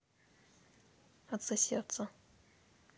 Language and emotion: Russian, neutral